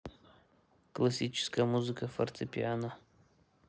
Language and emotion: Russian, neutral